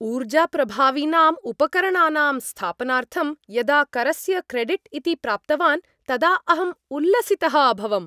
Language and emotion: Sanskrit, happy